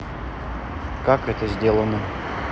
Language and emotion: Russian, neutral